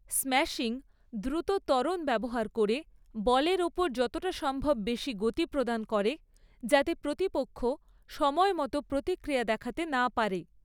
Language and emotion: Bengali, neutral